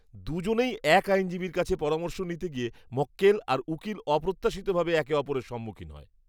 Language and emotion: Bengali, disgusted